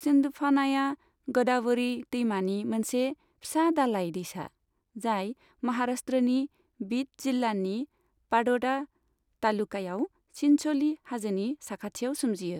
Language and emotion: Bodo, neutral